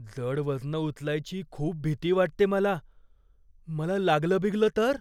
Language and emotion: Marathi, fearful